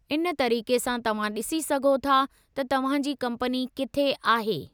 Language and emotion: Sindhi, neutral